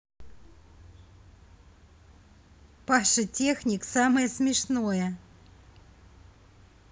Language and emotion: Russian, positive